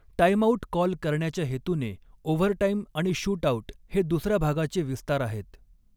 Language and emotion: Marathi, neutral